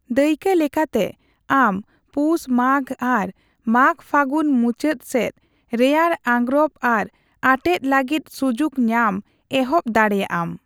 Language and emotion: Santali, neutral